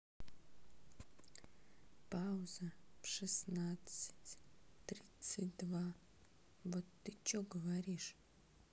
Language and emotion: Russian, neutral